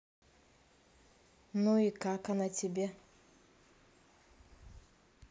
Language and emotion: Russian, neutral